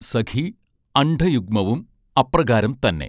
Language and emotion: Malayalam, neutral